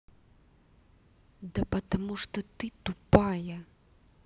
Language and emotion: Russian, angry